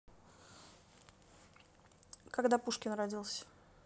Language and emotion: Russian, neutral